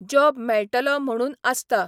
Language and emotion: Goan Konkani, neutral